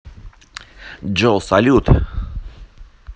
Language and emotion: Russian, positive